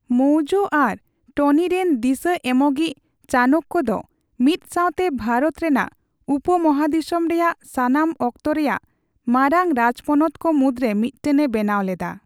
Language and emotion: Santali, neutral